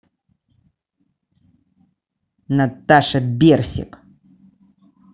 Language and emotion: Russian, angry